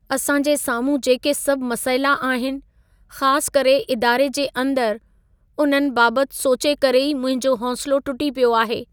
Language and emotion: Sindhi, sad